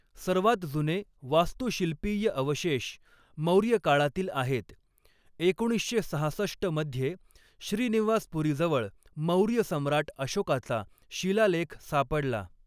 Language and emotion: Marathi, neutral